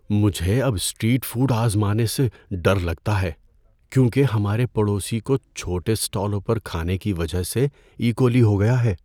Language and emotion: Urdu, fearful